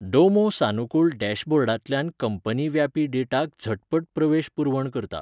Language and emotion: Goan Konkani, neutral